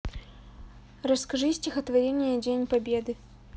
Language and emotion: Russian, neutral